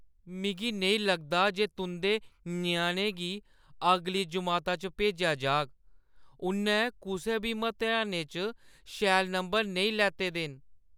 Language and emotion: Dogri, sad